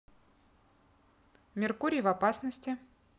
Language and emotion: Russian, neutral